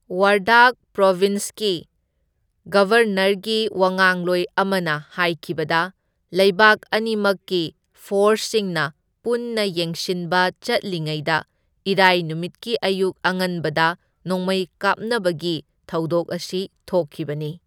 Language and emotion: Manipuri, neutral